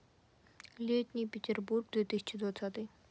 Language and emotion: Russian, neutral